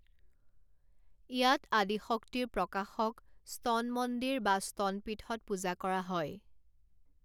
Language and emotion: Assamese, neutral